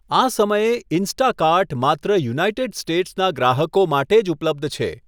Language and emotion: Gujarati, neutral